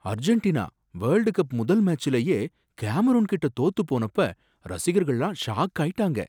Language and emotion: Tamil, surprised